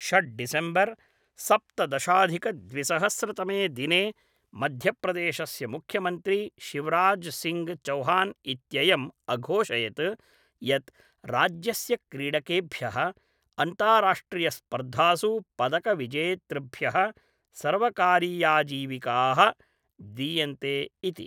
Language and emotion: Sanskrit, neutral